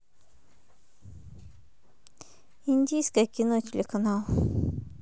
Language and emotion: Russian, neutral